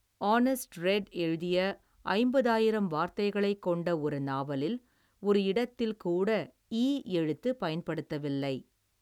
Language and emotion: Tamil, neutral